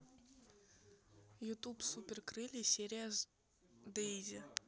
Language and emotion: Russian, neutral